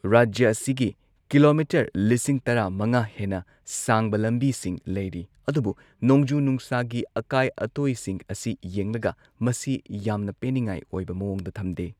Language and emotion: Manipuri, neutral